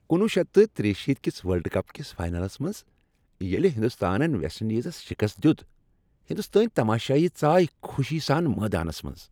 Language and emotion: Kashmiri, happy